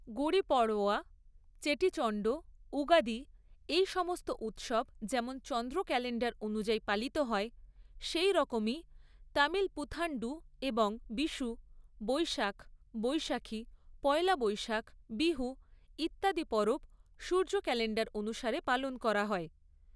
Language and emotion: Bengali, neutral